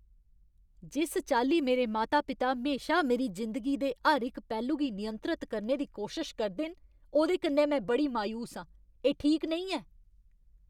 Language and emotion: Dogri, angry